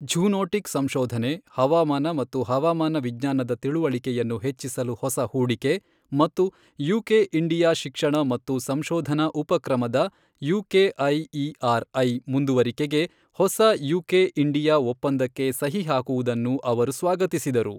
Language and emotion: Kannada, neutral